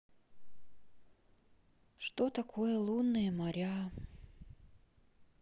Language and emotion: Russian, sad